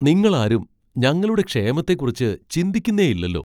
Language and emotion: Malayalam, surprised